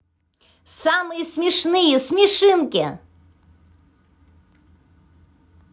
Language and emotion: Russian, positive